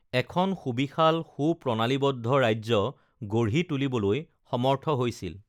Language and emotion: Assamese, neutral